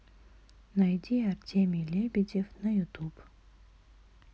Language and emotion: Russian, neutral